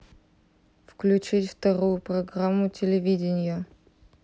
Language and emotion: Russian, neutral